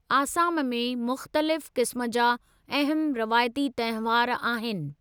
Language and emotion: Sindhi, neutral